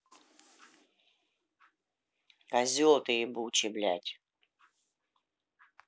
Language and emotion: Russian, angry